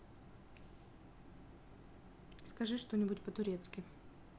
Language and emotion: Russian, neutral